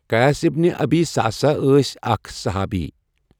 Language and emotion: Kashmiri, neutral